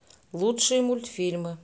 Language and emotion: Russian, neutral